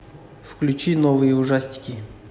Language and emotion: Russian, neutral